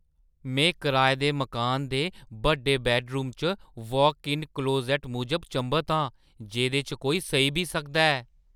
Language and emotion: Dogri, surprised